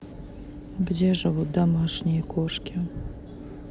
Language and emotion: Russian, sad